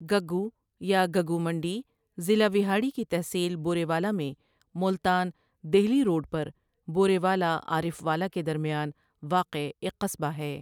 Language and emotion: Urdu, neutral